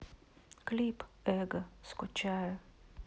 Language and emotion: Russian, sad